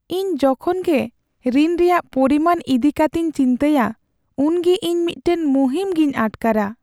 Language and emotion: Santali, sad